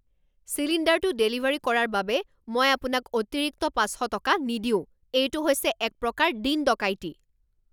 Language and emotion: Assamese, angry